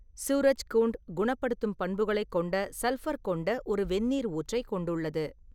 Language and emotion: Tamil, neutral